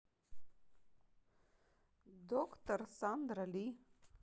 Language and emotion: Russian, neutral